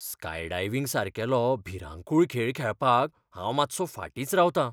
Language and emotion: Goan Konkani, fearful